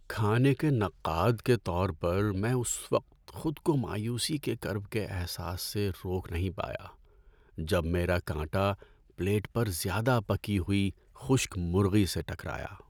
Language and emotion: Urdu, sad